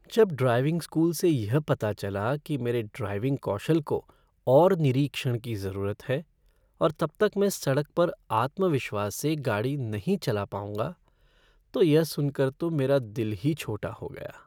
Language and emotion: Hindi, sad